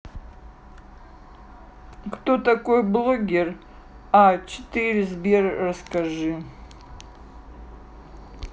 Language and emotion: Russian, neutral